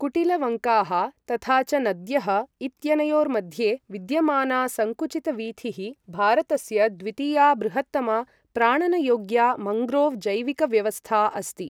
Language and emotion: Sanskrit, neutral